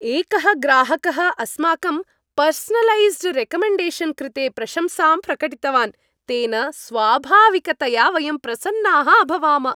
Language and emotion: Sanskrit, happy